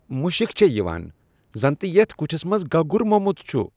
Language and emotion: Kashmiri, disgusted